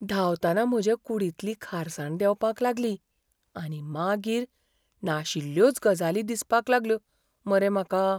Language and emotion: Goan Konkani, fearful